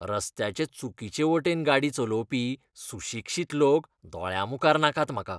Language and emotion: Goan Konkani, disgusted